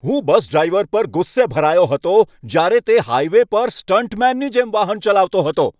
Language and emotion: Gujarati, angry